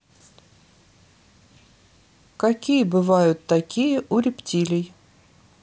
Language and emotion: Russian, neutral